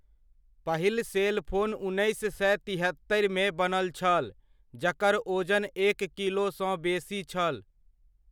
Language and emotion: Maithili, neutral